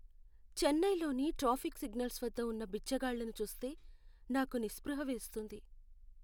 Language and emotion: Telugu, sad